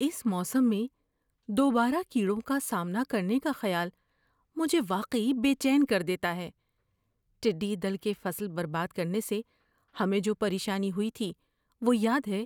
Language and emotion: Urdu, fearful